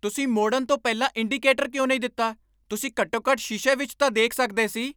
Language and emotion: Punjabi, angry